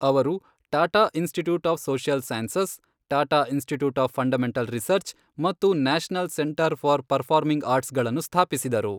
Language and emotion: Kannada, neutral